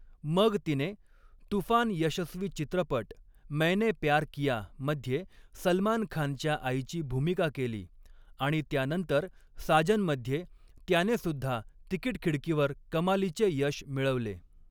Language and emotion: Marathi, neutral